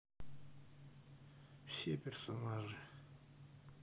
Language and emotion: Russian, neutral